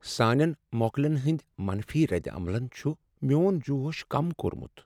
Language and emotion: Kashmiri, sad